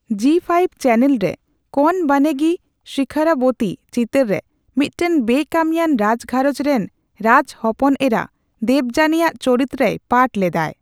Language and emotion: Santali, neutral